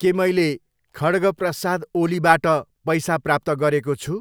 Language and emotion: Nepali, neutral